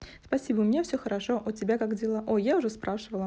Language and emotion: Russian, neutral